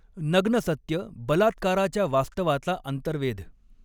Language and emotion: Marathi, neutral